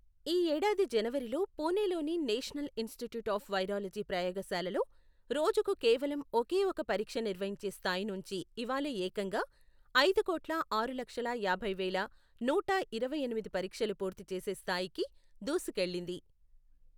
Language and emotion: Telugu, neutral